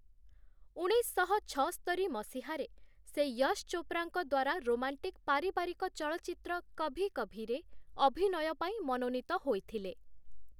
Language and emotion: Odia, neutral